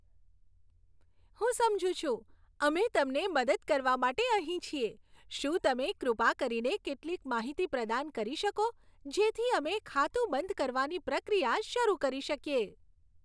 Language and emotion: Gujarati, happy